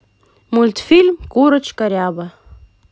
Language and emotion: Russian, positive